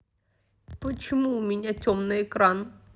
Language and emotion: Russian, angry